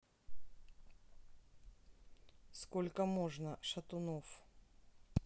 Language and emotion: Russian, neutral